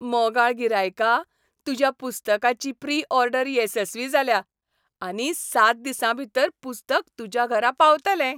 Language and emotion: Goan Konkani, happy